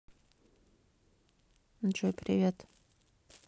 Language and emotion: Russian, neutral